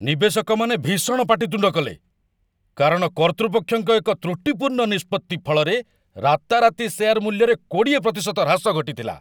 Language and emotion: Odia, angry